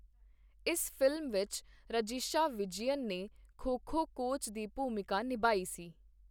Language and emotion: Punjabi, neutral